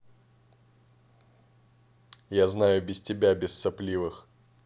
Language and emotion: Russian, angry